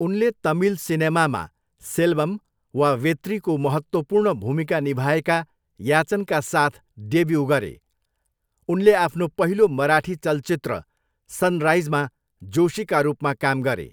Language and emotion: Nepali, neutral